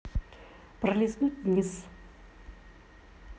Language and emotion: Russian, neutral